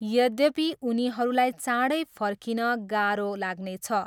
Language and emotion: Nepali, neutral